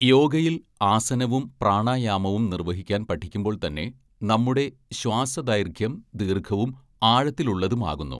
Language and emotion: Malayalam, neutral